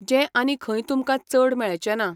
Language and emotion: Goan Konkani, neutral